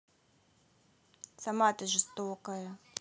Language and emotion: Russian, neutral